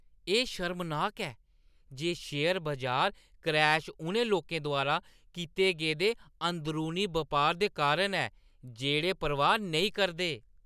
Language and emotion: Dogri, disgusted